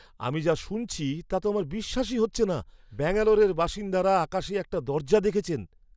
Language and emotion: Bengali, surprised